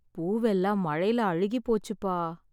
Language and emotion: Tamil, sad